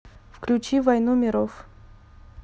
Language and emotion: Russian, neutral